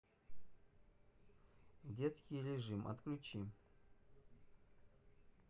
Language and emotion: Russian, neutral